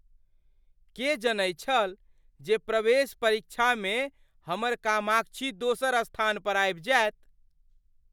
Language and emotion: Maithili, surprised